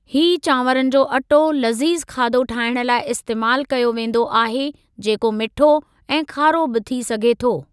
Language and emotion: Sindhi, neutral